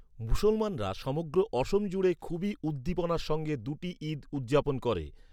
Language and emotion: Bengali, neutral